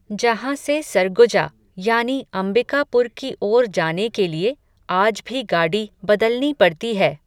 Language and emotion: Hindi, neutral